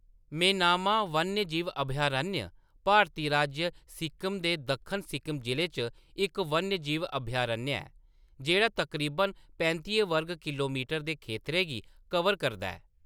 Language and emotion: Dogri, neutral